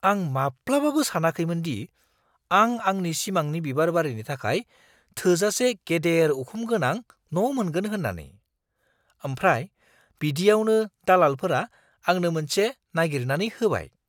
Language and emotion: Bodo, surprised